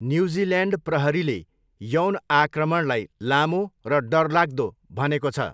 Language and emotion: Nepali, neutral